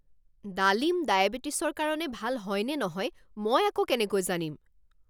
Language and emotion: Assamese, angry